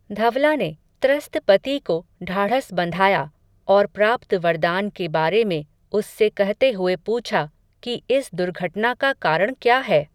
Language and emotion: Hindi, neutral